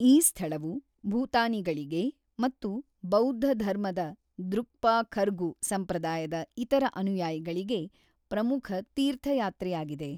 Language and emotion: Kannada, neutral